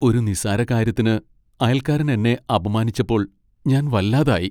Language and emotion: Malayalam, sad